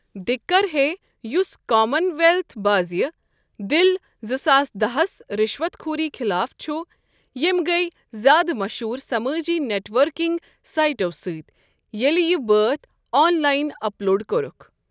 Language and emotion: Kashmiri, neutral